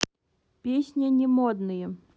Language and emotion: Russian, neutral